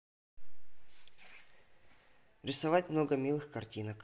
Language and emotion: Russian, neutral